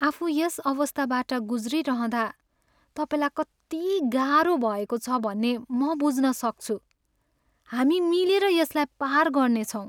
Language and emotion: Nepali, sad